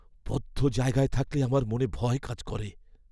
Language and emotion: Bengali, fearful